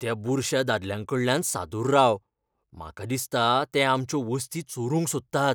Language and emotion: Goan Konkani, fearful